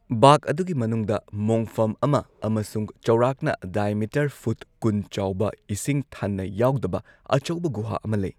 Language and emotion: Manipuri, neutral